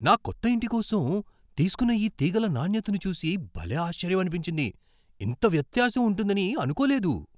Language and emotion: Telugu, surprised